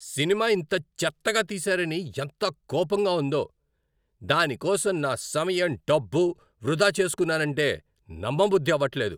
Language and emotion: Telugu, angry